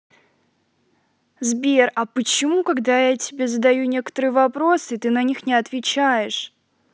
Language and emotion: Russian, angry